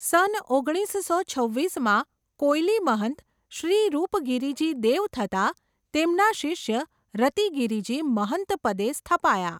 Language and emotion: Gujarati, neutral